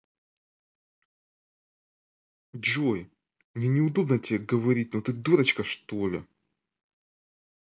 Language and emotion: Russian, angry